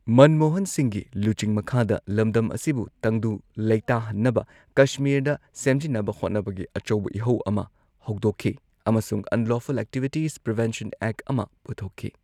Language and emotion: Manipuri, neutral